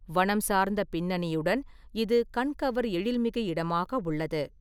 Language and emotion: Tamil, neutral